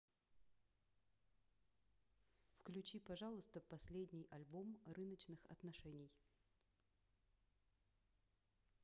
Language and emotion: Russian, neutral